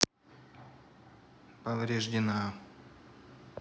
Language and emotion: Russian, neutral